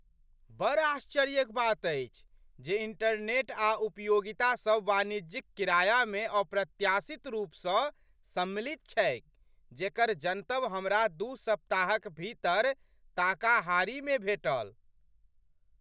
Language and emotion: Maithili, surprised